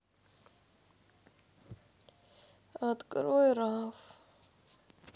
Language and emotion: Russian, sad